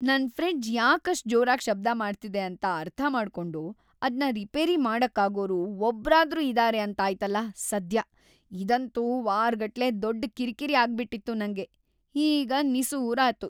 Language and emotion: Kannada, happy